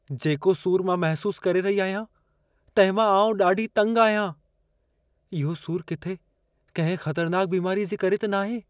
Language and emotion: Sindhi, fearful